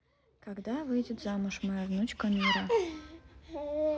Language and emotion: Russian, neutral